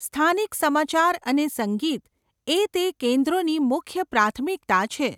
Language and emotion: Gujarati, neutral